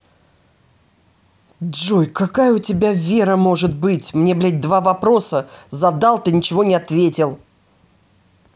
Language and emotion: Russian, angry